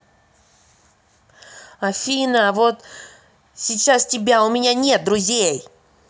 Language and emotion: Russian, angry